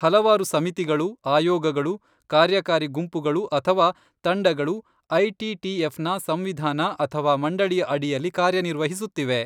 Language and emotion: Kannada, neutral